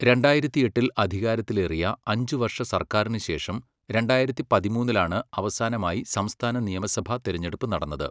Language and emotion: Malayalam, neutral